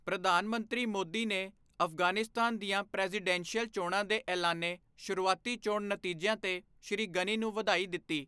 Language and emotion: Punjabi, neutral